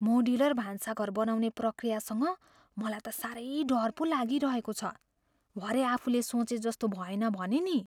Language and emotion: Nepali, fearful